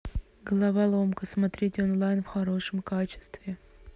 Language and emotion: Russian, neutral